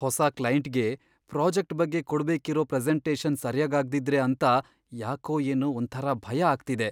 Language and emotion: Kannada, fearful